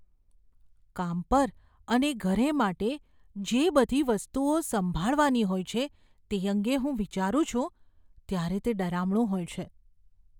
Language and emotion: Gujarati, fearful